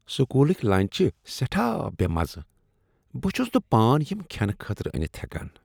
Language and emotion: Kashmiri, disgusted